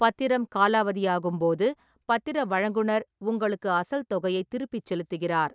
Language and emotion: Tamil, neutral